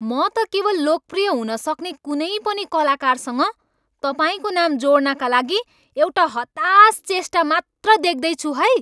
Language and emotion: Nepali, angry